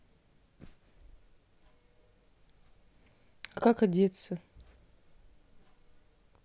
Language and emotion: Russian, neutral